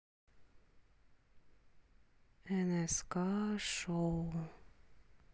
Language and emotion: Russian, sad